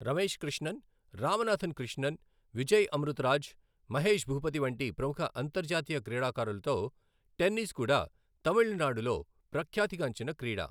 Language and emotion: Telugu, neutral